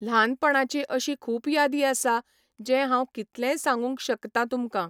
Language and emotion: Goan Konkani, neutral